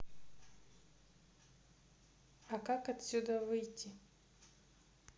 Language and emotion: Russian, neutral